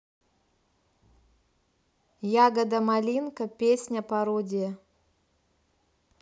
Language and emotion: Russian, neutral